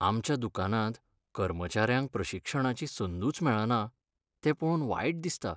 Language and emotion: Goan Konkani, sad